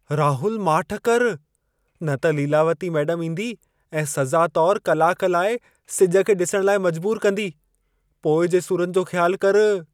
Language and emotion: Sindhi, fearful